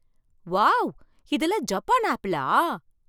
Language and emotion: Tamil, surprised